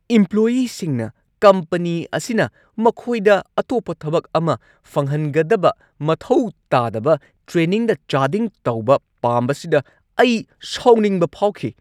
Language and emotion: Manipuri, angry